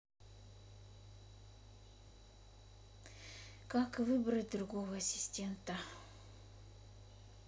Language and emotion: Russian, neutral